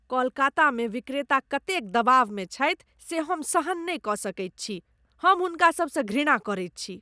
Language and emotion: Maithili, disgusted